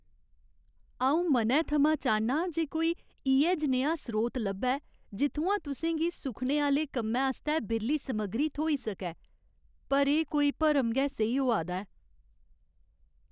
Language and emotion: Dogri, sad